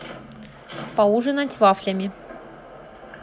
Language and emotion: Russian, neutral